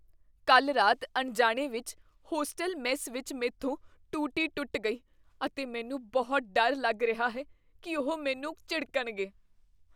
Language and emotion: Punjabi, fearful